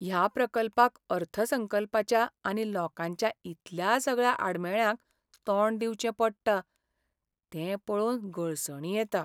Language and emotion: Goan Konkani, sad